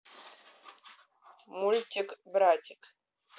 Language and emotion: Russian, neutral